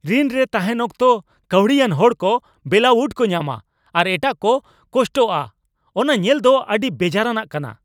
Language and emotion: Santali, angry